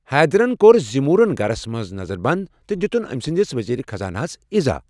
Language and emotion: Kashmiri, neutral